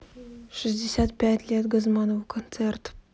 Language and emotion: Russian, neutral